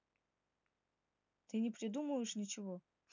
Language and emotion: Russian, neutral